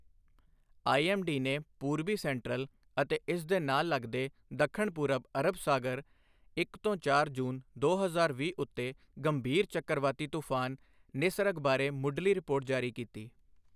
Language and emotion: Punjabi, neutral